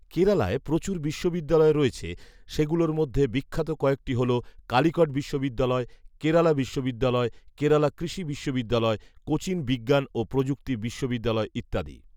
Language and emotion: Bengali, neutral